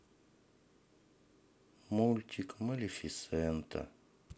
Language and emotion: Russian, sad